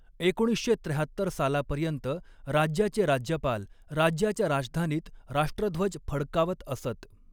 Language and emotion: Marathi, neutral